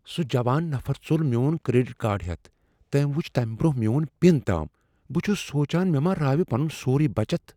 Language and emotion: Kashmiri, fearful